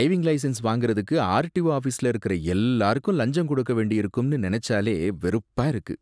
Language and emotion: Tamil, disgusted